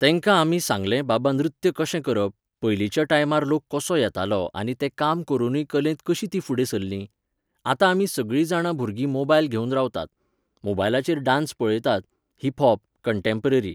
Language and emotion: Goan Konkani, neutral